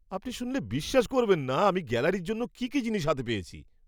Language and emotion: Bengali, surprised